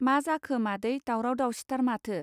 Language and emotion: Bodo, neutral